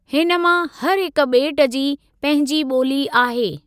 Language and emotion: Sindhi, neutral